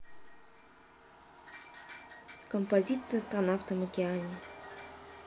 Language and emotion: Russian, neutral